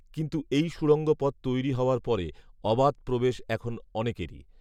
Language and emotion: Bengali, neutral